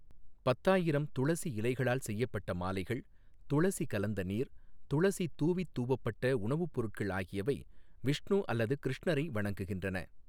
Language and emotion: Tamil, neutral